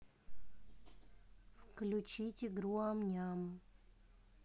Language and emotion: Russian, neutral